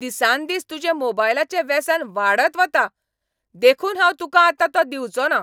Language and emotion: Goan Konkani, angry